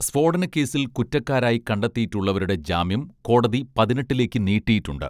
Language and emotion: Malayalam, neutral